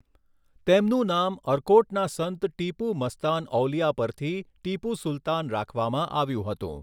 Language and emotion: Gujarati, neutral